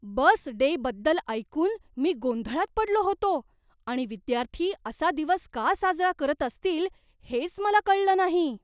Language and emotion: Marathi, surprised